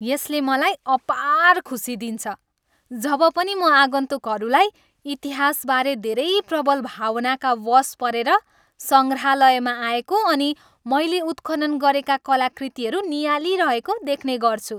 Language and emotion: Nepali, happy